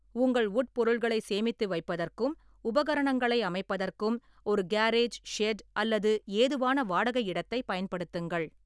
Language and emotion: Tamil, neutral